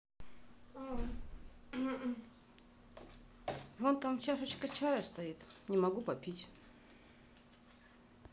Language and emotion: Russian, neutral